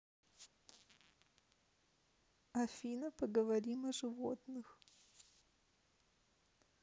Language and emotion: Russian, sad